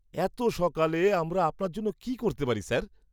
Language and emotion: Bengali, happy